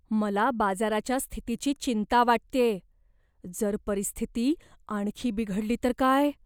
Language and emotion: Marathi, fearful